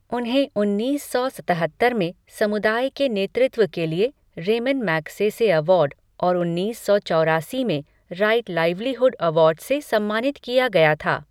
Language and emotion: Hindi, neutral